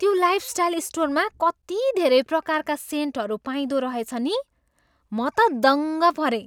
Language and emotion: Nepali, surprised